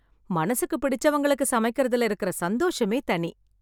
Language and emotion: Tamil, happy